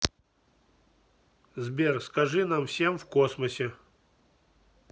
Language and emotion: Russian, neutral